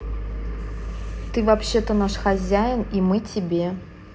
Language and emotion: Russian, neutral